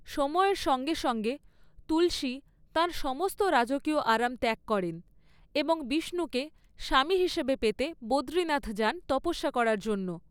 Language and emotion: Bengali, neutral